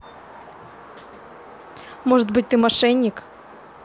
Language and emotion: Russian, neutral